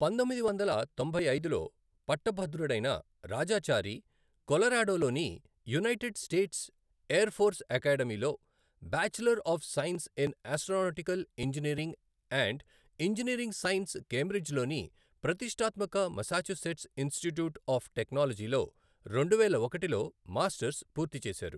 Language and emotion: Telugu, neutral